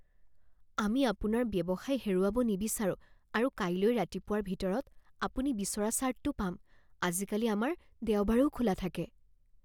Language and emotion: Assamese, fearful